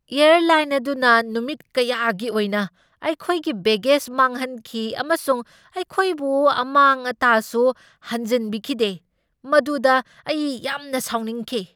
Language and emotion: Manipuri, angry